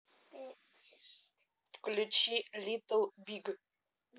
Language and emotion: Russian, neutral